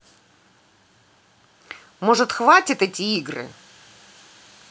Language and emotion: Russian, angry